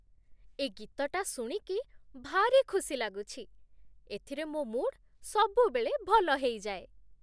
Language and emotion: Odia, happy